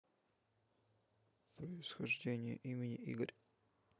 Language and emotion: Russian, neutral